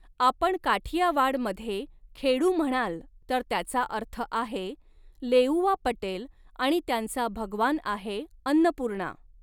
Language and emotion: Marathi, neutral